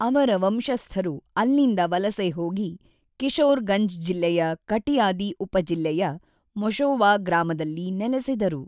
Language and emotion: Kannada, neutral